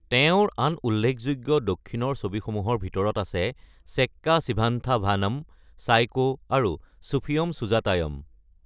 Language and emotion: Assamese, neutral